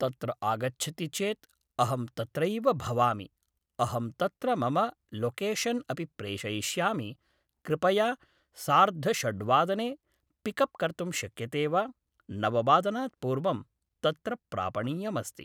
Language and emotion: Sanskrit, neutral